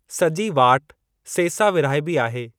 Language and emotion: Sindhi, neutral